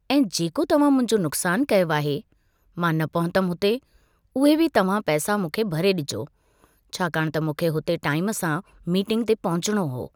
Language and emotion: Sindhi, neutral